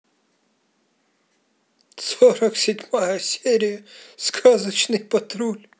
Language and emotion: Russian, positive